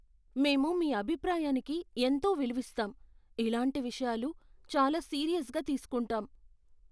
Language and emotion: Telugu, fearful